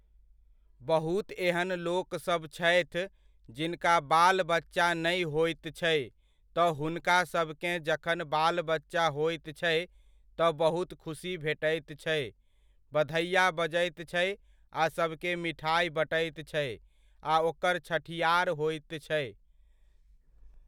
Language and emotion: Maithili, neutral